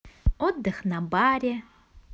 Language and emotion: Russian, positive